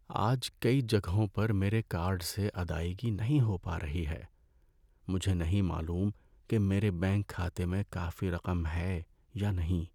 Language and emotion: Urdu, sad